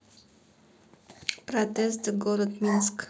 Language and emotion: Russian, neutral